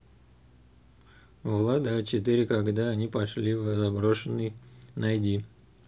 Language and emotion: Russian, neutral